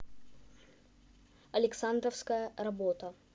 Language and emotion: Russian, neutral